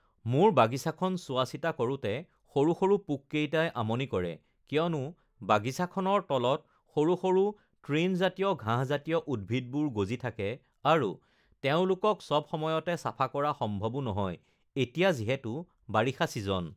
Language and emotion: Assamese, neutral